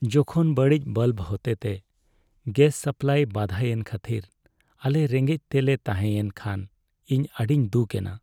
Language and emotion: Santali, sad